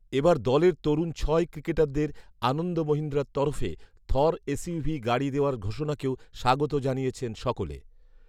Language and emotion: Bengali, neutral